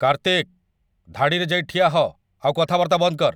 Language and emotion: Odia, angry